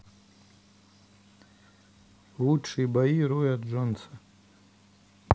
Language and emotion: Russian, neutral